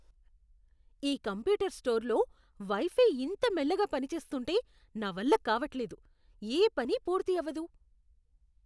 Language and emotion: Telugu, disgusted